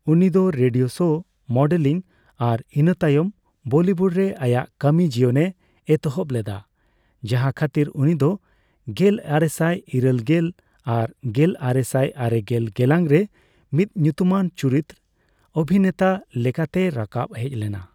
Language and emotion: Santali, neutral